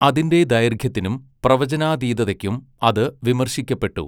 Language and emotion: Malayalam, neutral